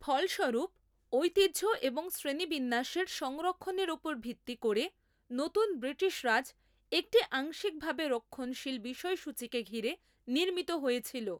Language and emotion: Bengali, neutral